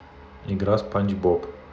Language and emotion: Russian, neutral